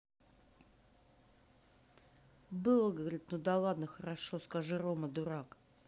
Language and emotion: Russian, angry